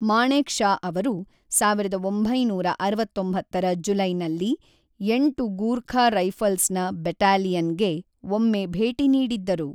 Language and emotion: Kannada, neutral